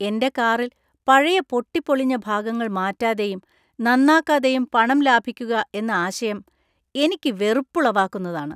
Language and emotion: Malayalam, disgusted